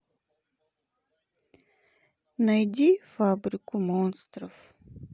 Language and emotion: Russian, sad